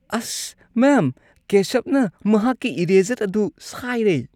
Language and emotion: Manipuri, disgusted